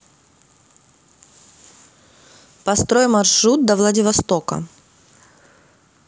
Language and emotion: Russian, neutral